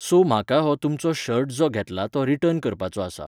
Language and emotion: Goan Konkani, neutral